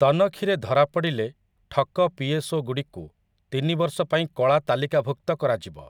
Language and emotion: Odia, neutral